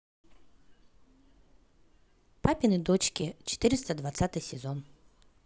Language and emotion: Russian, positive